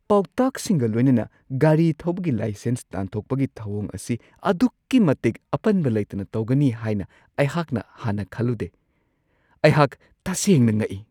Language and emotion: Manipuri, surprised